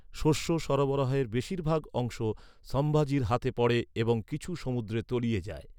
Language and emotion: Bengali, neutral